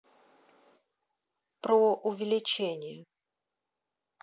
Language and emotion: Russian, neutral